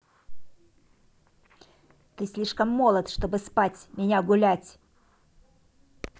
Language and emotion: Russian, angry